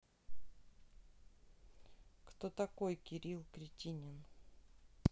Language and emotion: Russian, neutral